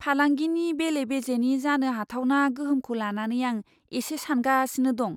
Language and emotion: Bodo, fearful